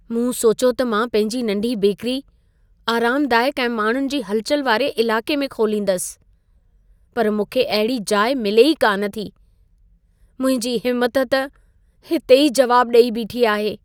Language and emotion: Sindhi, sad